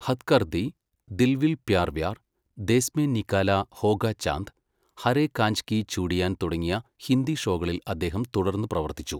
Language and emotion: Malayalam, neutral